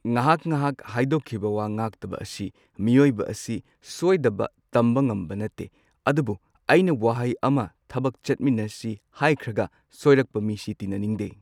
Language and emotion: Manipuri, neutral